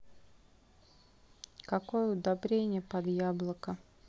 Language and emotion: Russian, neutral